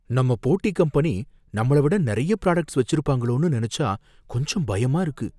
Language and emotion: Tamil, fearful